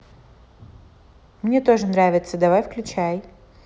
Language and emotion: Russian, neutral